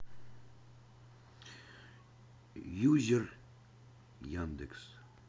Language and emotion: Russian, neutral